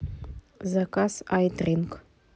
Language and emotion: Russian, neutral